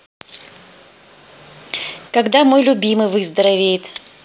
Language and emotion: Russian, positive